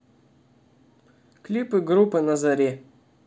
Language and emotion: Russian, neutral